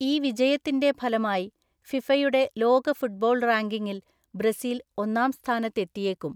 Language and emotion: Malayalam, neutral